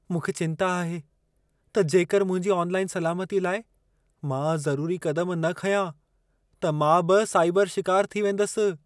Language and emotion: Sindhi, fearful